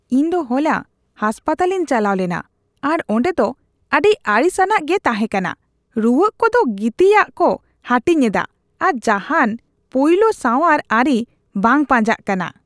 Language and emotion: Santali, disgusted